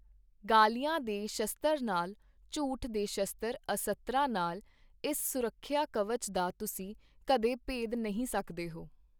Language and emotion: Punjabi, neutral